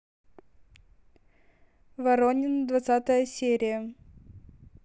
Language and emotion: Russian, neutral